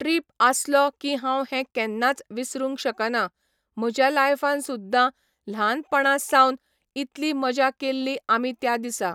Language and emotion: Goan Konkani, neutral